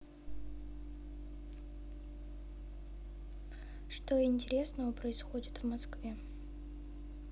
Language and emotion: Russian, neutral